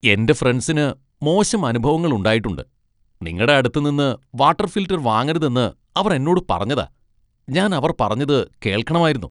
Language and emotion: Malayalam, disgusted